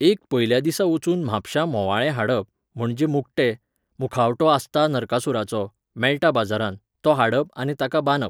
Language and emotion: Goan Konkani, neutral